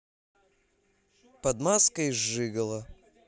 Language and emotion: Russian, neutral